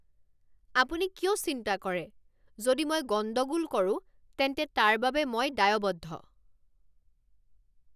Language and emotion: Assamese, angry